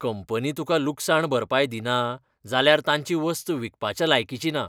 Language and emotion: Goan Konkani, disgusted